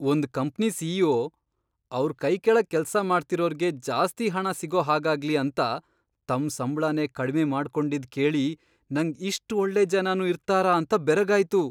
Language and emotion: Kannada, surprised